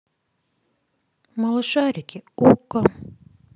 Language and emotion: Russian, neutral